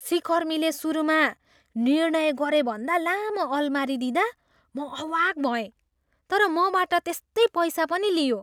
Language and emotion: Nepali, surprised